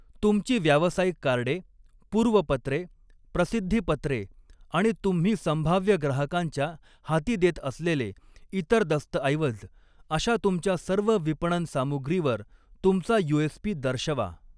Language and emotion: Marathi, neutral